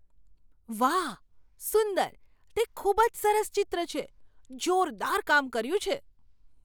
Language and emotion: Gujarati, surprised